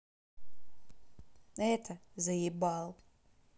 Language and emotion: Russian, neutral